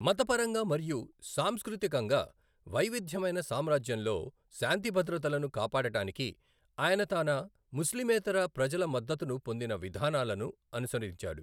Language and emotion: Telugu, neutral